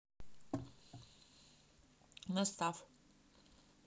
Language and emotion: Russian, neutral